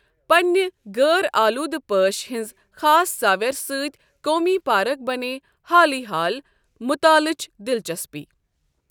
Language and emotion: Kashmiri, neutral